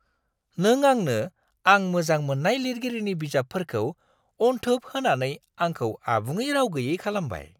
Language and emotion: Bodo, surprised